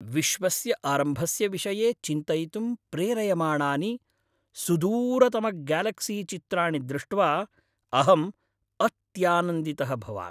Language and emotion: Sanskrit, happy